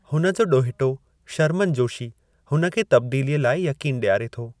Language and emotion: Sindhi, neutral